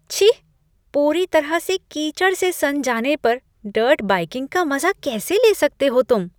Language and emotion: Hindi, disgusted